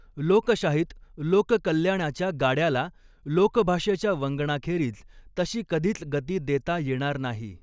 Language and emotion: Marathi, neutral